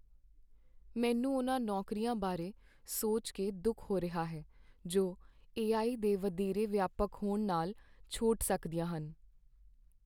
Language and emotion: Punjabi, sad